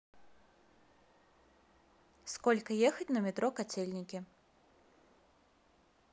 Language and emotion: Russian, neutral